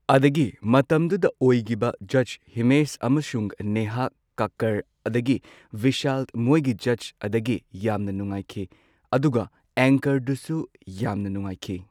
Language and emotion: Manipuri, neutral